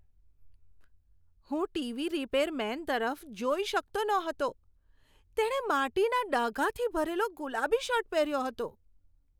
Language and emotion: Gujarati, disgusted